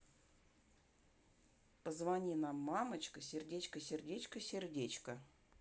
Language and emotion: Russian, neutral